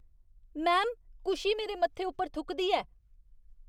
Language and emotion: Dogri, disgusted